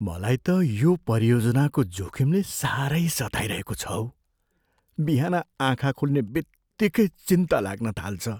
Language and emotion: Nepali, fearful